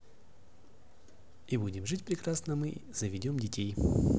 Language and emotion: Russian, positive